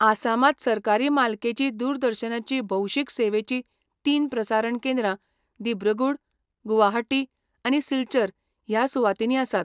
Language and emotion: Goan Konkani, neutral